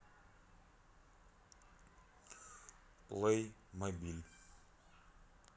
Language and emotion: Russian, neutral